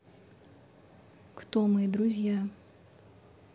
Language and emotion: Russian, neutral